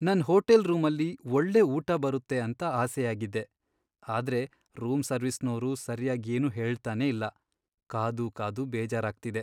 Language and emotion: Kannada, sad